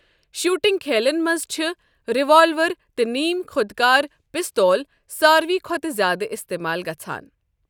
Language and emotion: Kashmiri, neutral